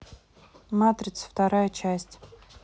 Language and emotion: Russian, neutral